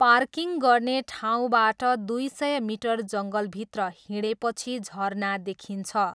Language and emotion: Nepali, neutral